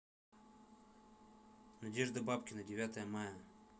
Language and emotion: Russian, neutral